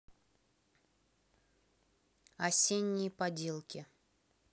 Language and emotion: Russian, neutral